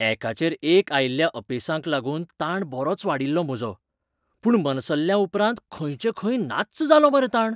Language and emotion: Goan Konkani, surprised